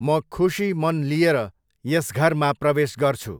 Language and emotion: Nepali, neutral